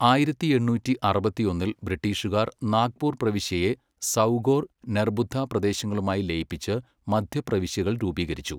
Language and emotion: Malayalam, neutral